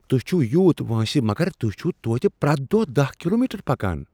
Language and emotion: Kashmiri, surprised